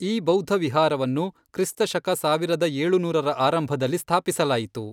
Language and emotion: Kannada, neutral